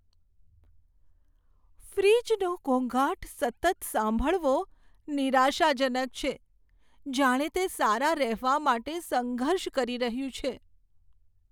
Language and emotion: Gujarati, sad